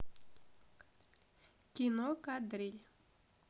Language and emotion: Russian, neutral